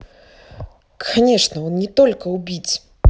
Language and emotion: Russian, neutral